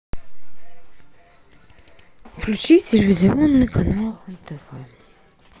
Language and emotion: Russian, sad